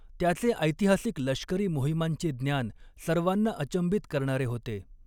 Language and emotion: Marathi, neutral